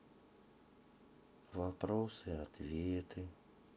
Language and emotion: Russian, sad